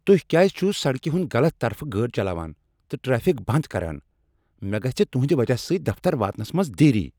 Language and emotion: Kashmiri, angry